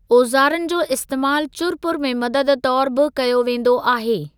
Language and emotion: Sindhi, neutral